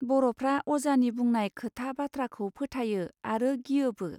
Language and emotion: Bodo, neutral